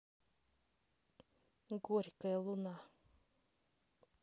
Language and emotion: Russian, neutral